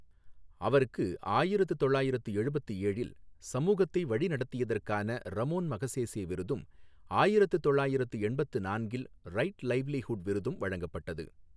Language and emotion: Tamil, neutral